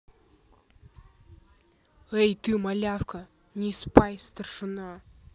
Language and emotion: Russian, angry